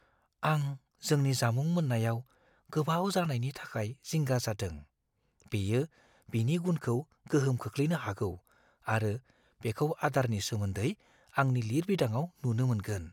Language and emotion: Bodo, fearful